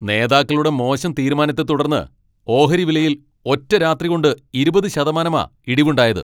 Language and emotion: Malayalam, angry